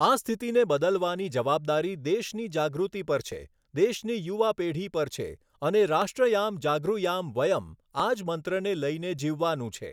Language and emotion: Gujarati, neutral